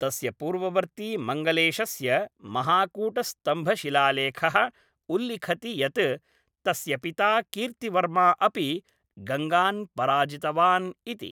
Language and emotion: Sanskrit, neutral